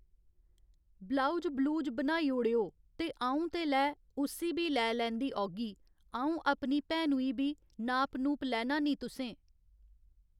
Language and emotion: Dogri, neutral